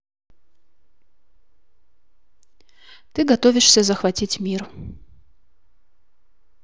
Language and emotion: Russian, neutral